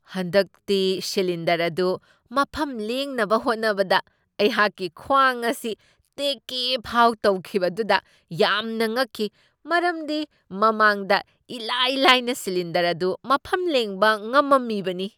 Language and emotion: Manipuri, surprised